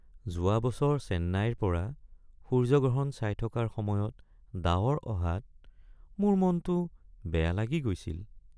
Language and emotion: Assamese, sad